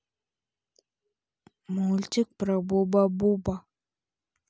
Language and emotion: Russian, neutral